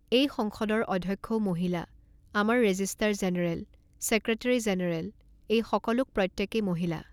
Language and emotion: Assamese, neutral